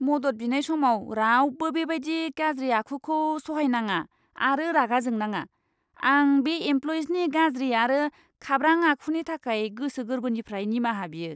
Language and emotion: Bodo, disgusted